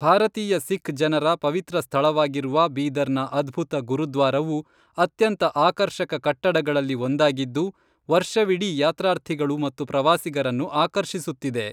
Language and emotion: Kannada, neutral